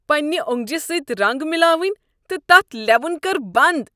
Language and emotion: Kashmiri, disgusted